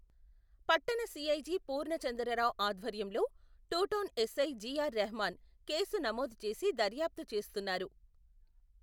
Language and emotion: Telugu, neutral